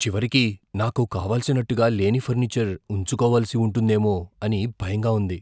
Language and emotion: Telugu, fearful